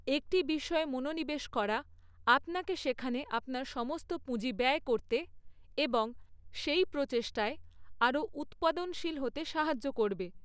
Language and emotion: Bengali, neutral